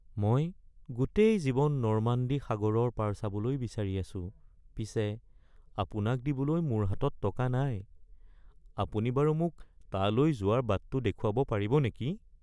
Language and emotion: Assamese, sad